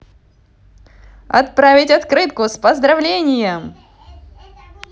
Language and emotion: Russian, positive